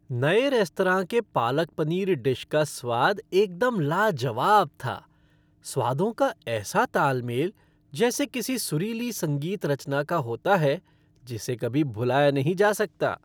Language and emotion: Hindi, happy